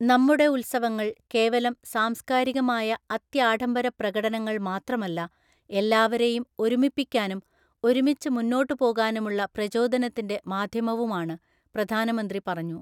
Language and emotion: Malayalam, neutral